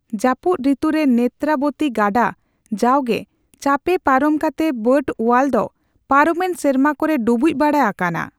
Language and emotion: Santali, neutral